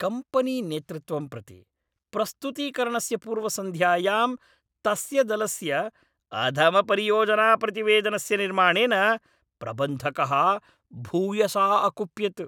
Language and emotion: Sanskrit, angry